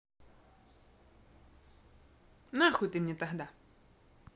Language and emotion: Russian, angry